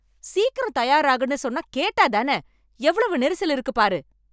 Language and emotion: Tamil, angry